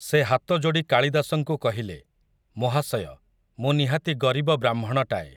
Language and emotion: Odia, neutral